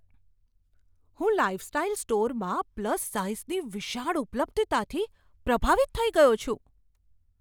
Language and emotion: Gujarati, surprised